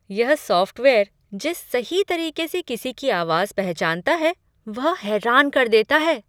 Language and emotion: Hindi, surprised